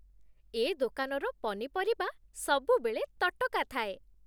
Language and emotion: Odia, happy